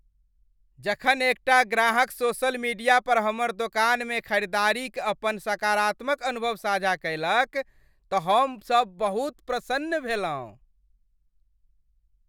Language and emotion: Maithili, happy